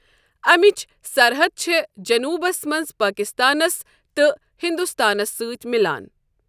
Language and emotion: Kashmiri, neutral